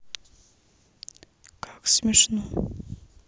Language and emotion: Russian, sad